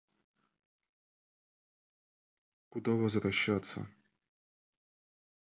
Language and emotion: Russian, neutral